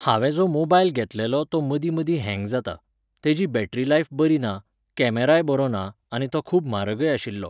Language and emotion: Goan Konkani, neutral